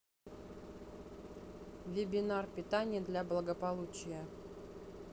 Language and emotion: Russian, neutral